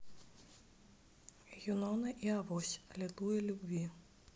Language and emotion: Russian, neutral